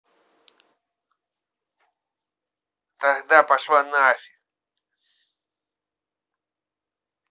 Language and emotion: Russian, angry